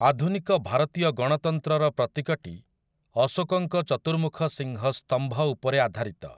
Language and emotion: Odia, neutral